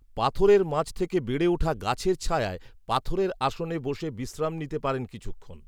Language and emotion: Bengali, neutral